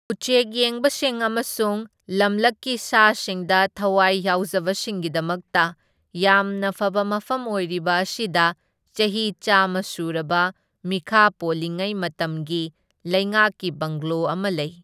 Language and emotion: Manipuri, neutral